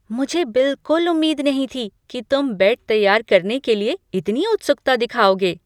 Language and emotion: Hindi, surprised